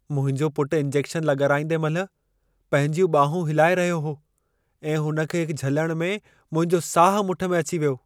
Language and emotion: Sindhi, fearful